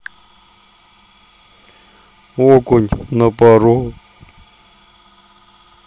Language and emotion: Russian, neutral